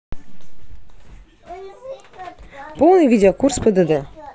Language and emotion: Russian, positive